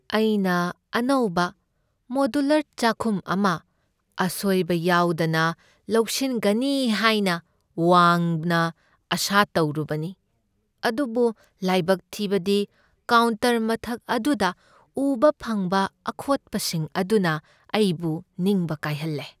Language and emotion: Manipuri, sad